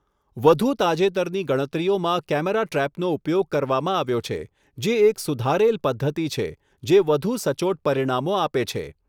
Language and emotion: Gujarati, neutral